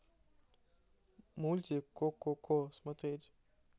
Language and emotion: Russian, neutral